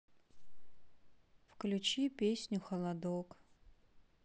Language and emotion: Russian, sad